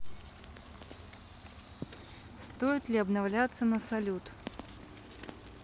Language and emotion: Russian, neutral